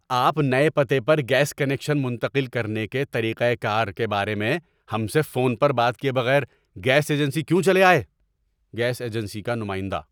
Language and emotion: Urdu, angry